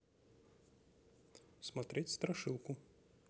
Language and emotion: Russian, neutral